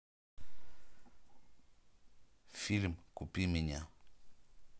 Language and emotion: Russian, neutral